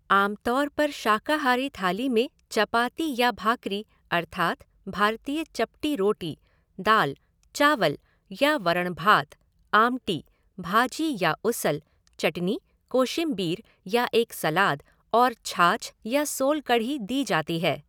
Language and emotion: Hindi, neutral